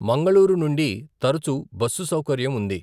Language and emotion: Telugu, neutral